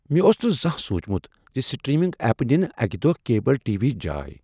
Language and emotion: Kashmiri, surprised